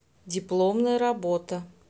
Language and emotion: Russian, neutral